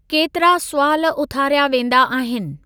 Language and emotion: Sindhi, neutral